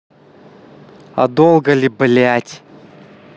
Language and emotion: Russian, angry